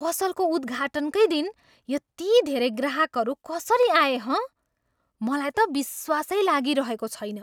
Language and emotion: Nepali, surprised